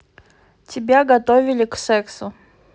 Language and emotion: Russian, neutral